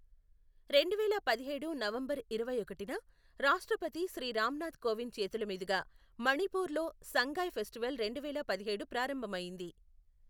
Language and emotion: Telugu, neutral